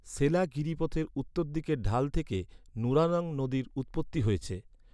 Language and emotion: Bengali, neutral